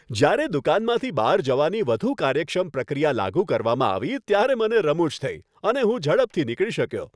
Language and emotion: Gujarati, happy